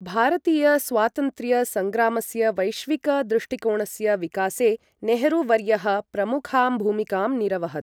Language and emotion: Sanskrit, neutral